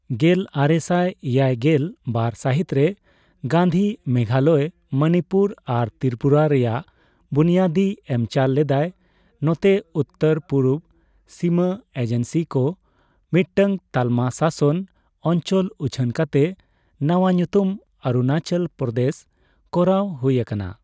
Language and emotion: Santali, neutral